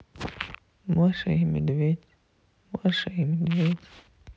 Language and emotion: Russian, sad